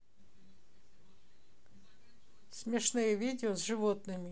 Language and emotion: Russian, neutral